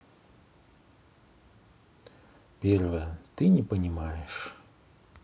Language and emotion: Russian, sad